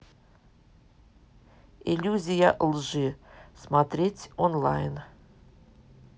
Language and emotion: Russian, neutral